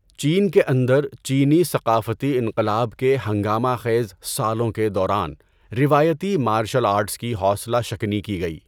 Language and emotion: Urdu, neutral